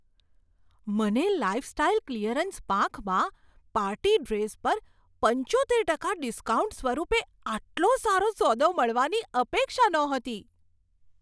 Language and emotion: Gujarati, surprised